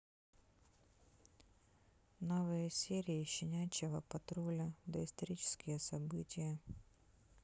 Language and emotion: Russian, neutral